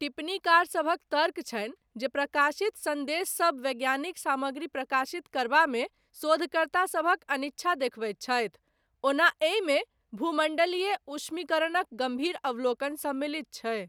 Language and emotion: Maithili, neutral